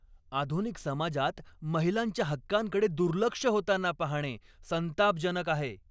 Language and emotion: Marathi, angry